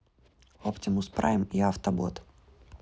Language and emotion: Russian, neutral